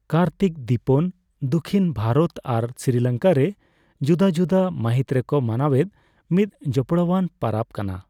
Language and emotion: Santali, neutral